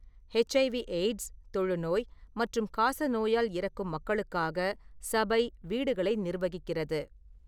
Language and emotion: Tamil, neutral